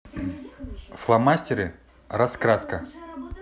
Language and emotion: Russian, neutral